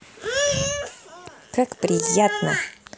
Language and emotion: Russian, angry